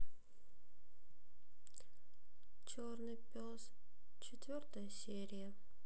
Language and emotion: Russian, sad